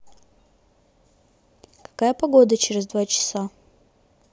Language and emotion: Russian, neutral